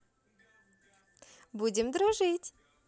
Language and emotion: Russian, positive